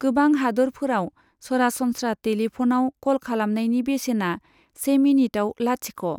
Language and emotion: Bodo, neutral